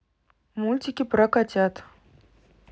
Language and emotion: Russian, neutral